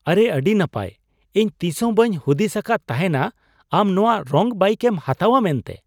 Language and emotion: Santali, surprised